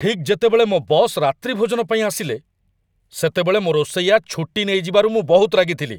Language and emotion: Odia, angry